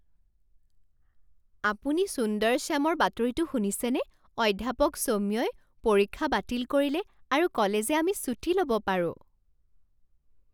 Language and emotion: Assamese, surprised